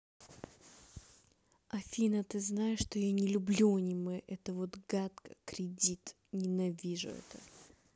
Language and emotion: Russian, angry